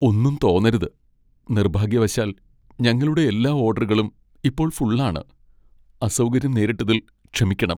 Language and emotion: Malayalam, sad